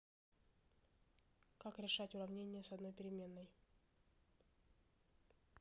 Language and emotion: Russian, neutral